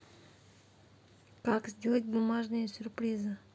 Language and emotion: Russian, neutral